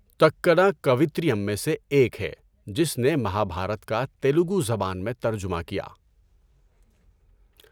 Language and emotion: Urdu, neutral